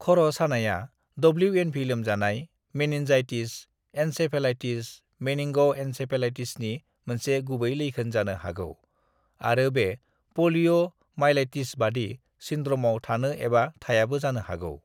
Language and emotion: Bodo, neutral